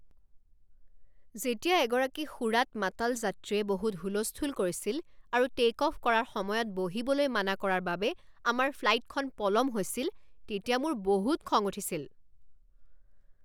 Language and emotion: Assamese, angry